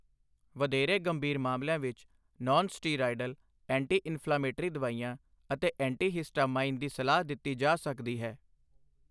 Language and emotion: Punjabi, neutral